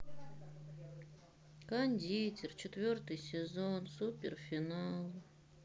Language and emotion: Russian, sad